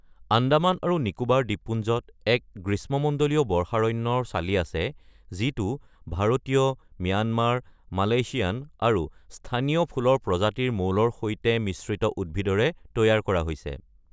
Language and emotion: Assamese, neutral